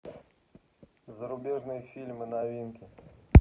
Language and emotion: Russian, neutral